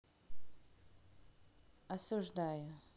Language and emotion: Russian, neutral